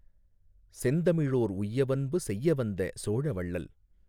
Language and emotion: Tamil, neutral